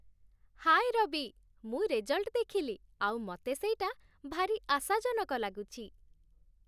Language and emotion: Odia, happy